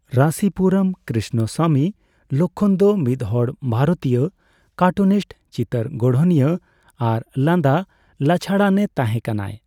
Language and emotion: Santali, neutral